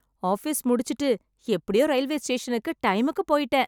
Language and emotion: Tamil, happy